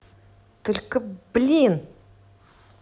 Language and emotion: Russian, angry